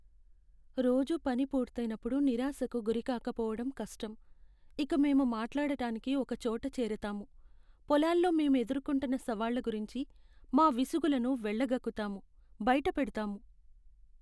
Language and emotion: Telugu, sad